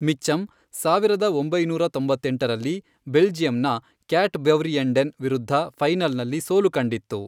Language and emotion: Kannada, neutral